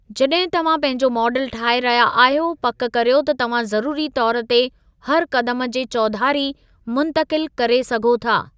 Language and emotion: Sindhi, neutral